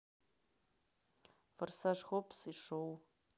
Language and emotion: Russian, neutral